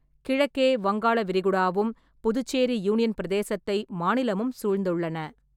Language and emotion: Tamil, neutral